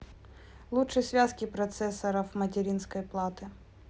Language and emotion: Russian, neutral